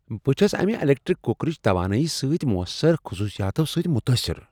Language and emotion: Kashmiri, surprised